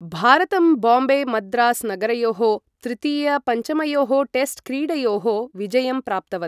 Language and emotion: Sanskrit, neutral